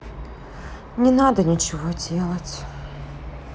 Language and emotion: Russian, sad